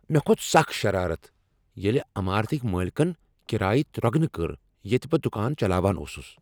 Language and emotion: Kashmiri, angry